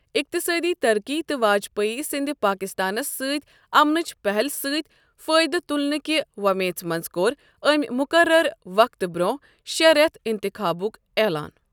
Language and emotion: Kashmiri, neutral